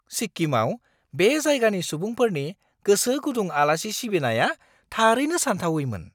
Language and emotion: Bodo, surprised